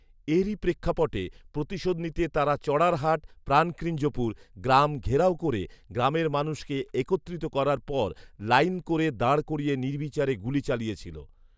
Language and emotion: Bengali, neutral